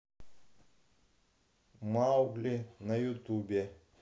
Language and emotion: Russian, neutral